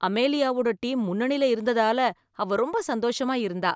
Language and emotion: Tamil, happy